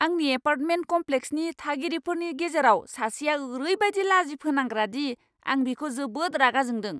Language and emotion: Bodo, angry